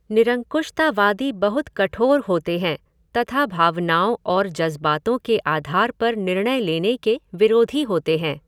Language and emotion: Hindi, neutral